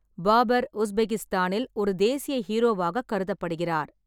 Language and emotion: Tamil, neutral